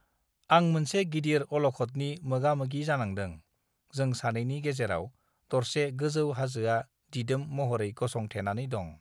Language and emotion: Bodo, neutral